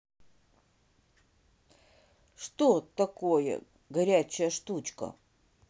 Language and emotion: Russian, neutral